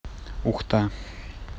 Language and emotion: Russian, neutral